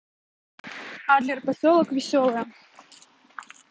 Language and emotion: Russian, neutral